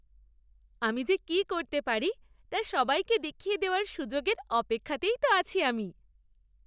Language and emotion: Bengali, happy